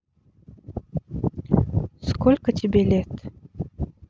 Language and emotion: Russian, neutral